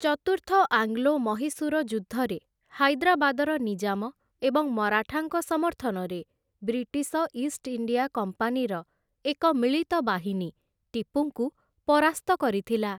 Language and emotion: Odia, neutral